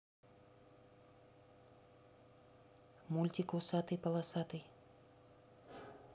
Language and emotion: Russian, neutral